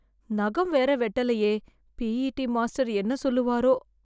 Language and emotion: Tamil, fearful